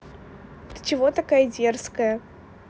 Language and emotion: Russian, neutral